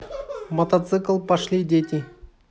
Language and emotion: Russian, neutral